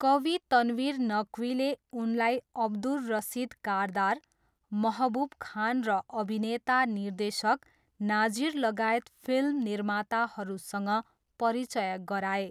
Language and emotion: Nepali, neutral